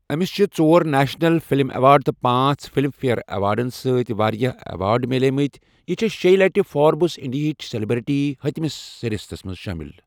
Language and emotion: Kashmiri, neutral